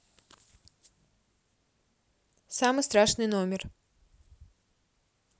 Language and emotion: Russian, neutral